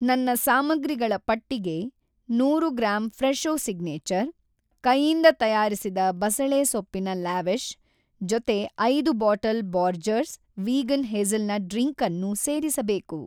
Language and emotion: Kannada, neutral